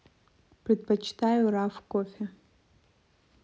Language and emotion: Russian, neutral